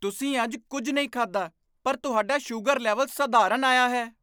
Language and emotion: Punjabi, surprised